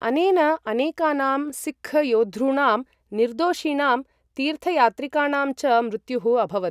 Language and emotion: Sanskrit, neutral